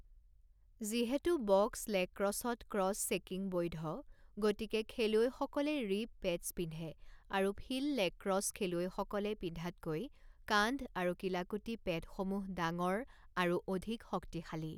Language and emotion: Assamese, neutral